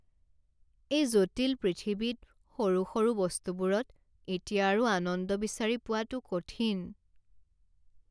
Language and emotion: Assamese, sad